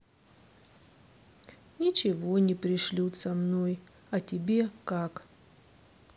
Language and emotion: Russian, sad